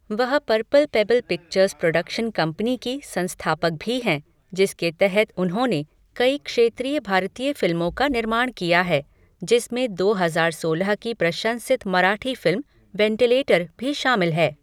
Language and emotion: Hindi, neutral